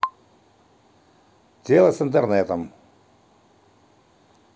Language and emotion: Russian, neutral